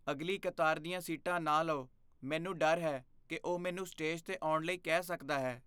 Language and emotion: Punjabi, fearful